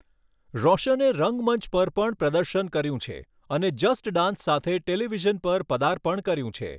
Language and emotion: Gujarati, neutral